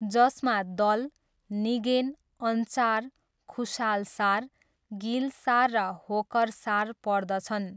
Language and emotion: Nepali, neutral